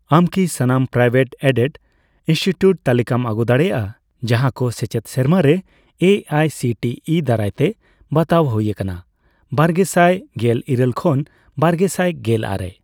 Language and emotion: Santali, neutral